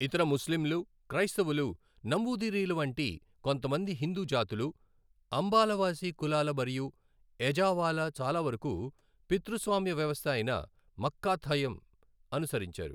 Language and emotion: Telugu, neutral